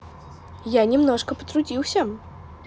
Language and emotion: Russian, positive